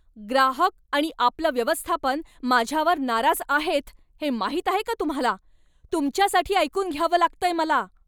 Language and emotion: Marathi, angry